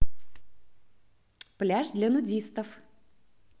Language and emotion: Russian, positive